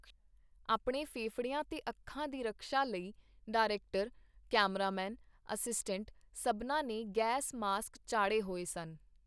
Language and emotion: Punjabi, neutral